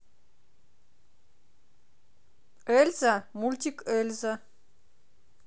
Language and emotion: Russian, positive